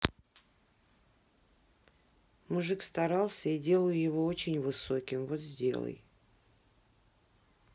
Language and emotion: Russian, neutral